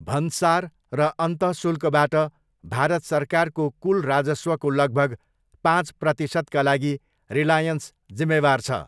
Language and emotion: Nepali, neutral